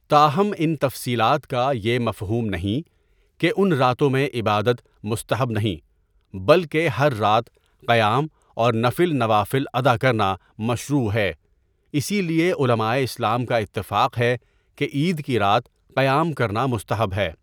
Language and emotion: Urdu, neutral